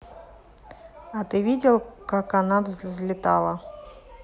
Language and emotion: Russian, neutral